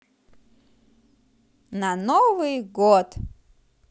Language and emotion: Russian, positive